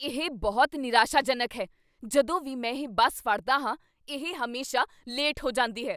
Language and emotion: Punjabi, angry